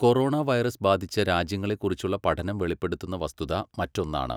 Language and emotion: Malayalam, neutral